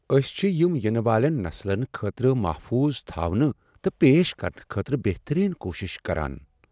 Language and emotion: Kashmiri, sad